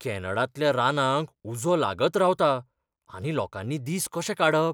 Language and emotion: Goan Konkani, fearful